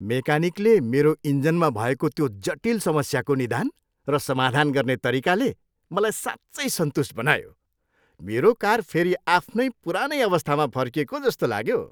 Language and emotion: Nepali, happy